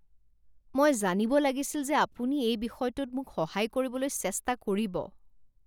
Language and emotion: Assamese, disgusted